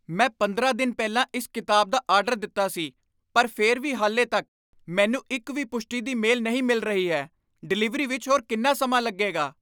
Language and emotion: Punjabi, angry